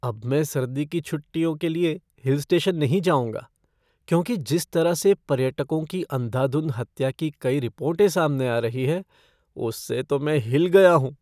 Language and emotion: Hindi, fearful